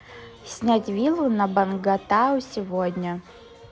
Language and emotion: Russian, neutral